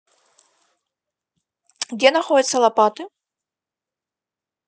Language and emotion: Russian, neutral